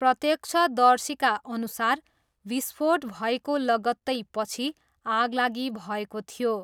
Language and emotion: Nepali, neutral